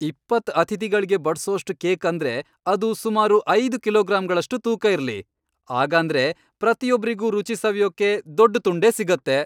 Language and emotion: Kannada, happy